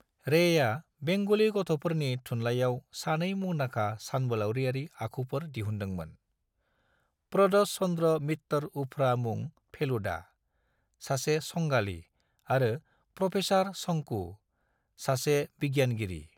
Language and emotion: Bodo, neutral